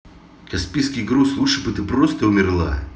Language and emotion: Russian, angry